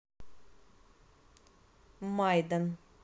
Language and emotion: Russian, neutral